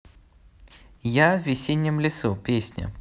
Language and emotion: Russian, positive